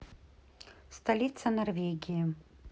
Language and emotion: Russian, neutral